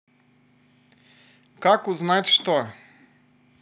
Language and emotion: Russian, positive